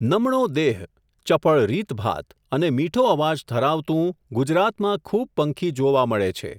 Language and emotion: Gujarati, neutral